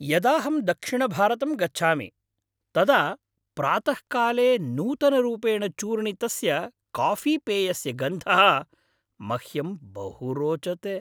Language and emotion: Sanskrit, happy